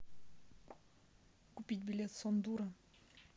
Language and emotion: Russian, neutral